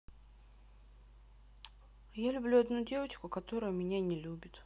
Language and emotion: Russian, sad